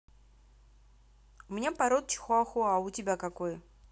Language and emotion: Russian, neutral